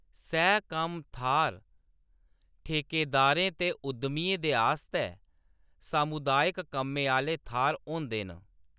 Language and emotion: Dogri, neutral